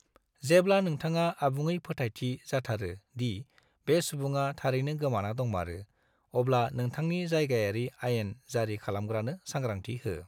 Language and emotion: Bodo, neutral